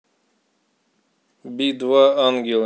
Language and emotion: Russian, neutral